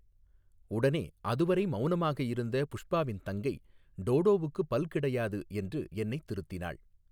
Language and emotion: Tamil, neutral